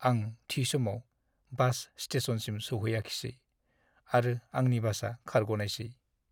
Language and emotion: Bodo, sad